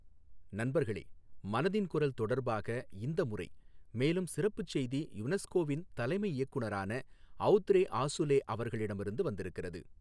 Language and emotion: Tamil, neutral